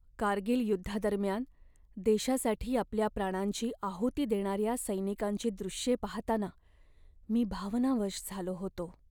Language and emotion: Marathi, sad